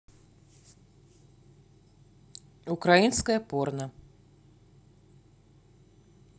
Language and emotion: Russian, neutral